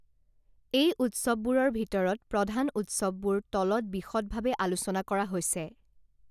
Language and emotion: Assamese, neutral